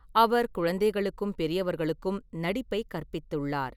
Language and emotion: Tamil, neutral